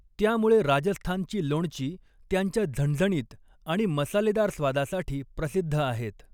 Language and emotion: Marathi, neutral